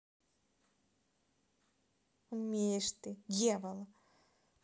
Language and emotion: Russian, neutral